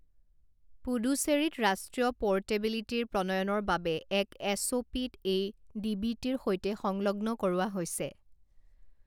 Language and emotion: Assamese, neutral